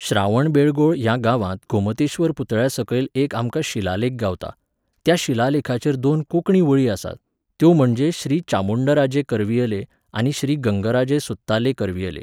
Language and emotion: Goan Konkani, neutral